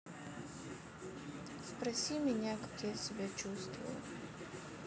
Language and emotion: Russian, sad